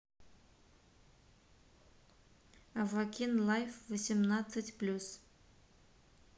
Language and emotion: Russian, neutral